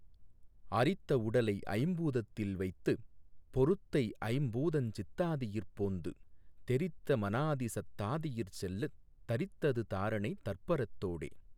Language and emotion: Tamil, neutral